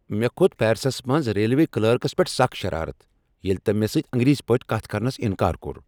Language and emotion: Kashmiri, angry